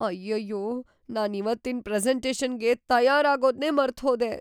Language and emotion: Kannada, fearful